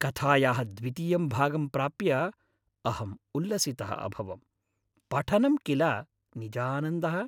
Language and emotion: Sanskrit, happy